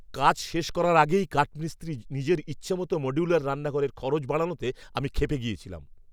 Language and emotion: Bengali, angry